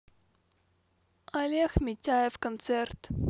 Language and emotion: Russian, neutral